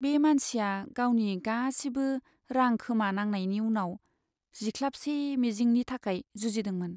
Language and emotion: Bodo, sad